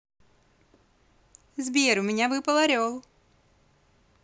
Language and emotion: Russian, positive